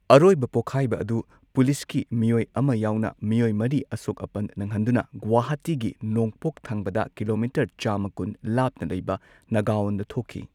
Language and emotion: Manipuri, neutral